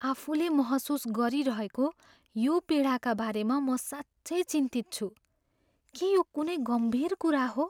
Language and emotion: Nepali, fearful